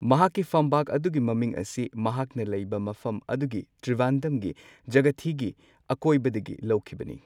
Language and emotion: Manipuri, neutral